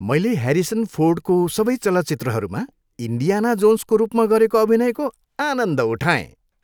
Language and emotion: Nepali, happy